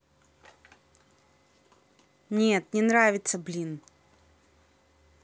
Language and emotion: Russian, angry